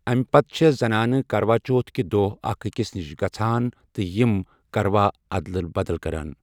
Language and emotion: Kashmiri, neutral